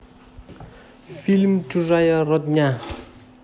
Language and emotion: Russian, neutral